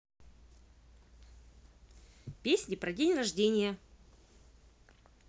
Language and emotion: Russian, positive